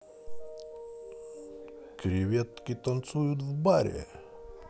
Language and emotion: Russian, positive